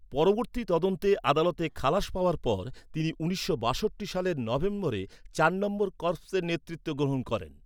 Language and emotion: Bengali, neutral